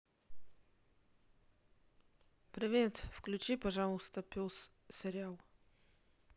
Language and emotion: Russian, neutral